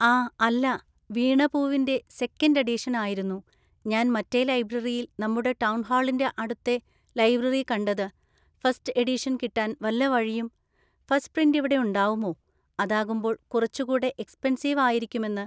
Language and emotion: Malayalam, neutral